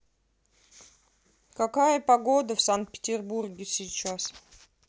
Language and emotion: Russian, neutral